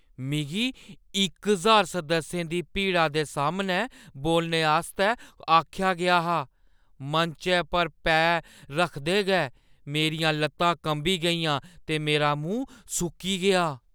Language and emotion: Dogri, fearful